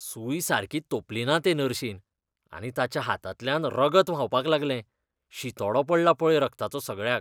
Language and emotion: Goan Konkani, disgusted